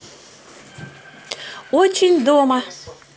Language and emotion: Russian, positive